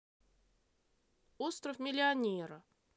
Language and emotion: Russian, neutral